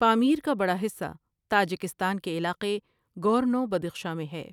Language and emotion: Urdu, neutral